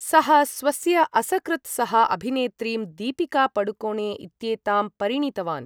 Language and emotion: Sanskrit, neutral